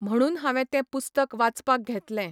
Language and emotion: Goan Konkani, neutral